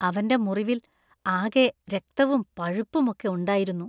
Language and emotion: Malayalam, disgusted